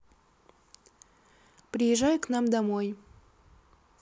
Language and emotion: Russian, neutral